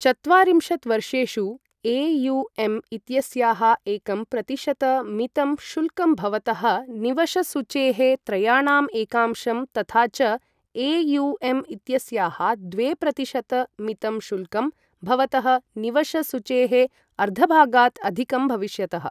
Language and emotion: Sanskrit, neutral